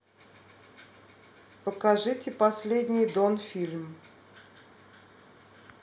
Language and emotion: Russian, neutral